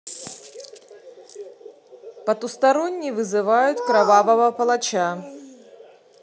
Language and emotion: Russian, neutral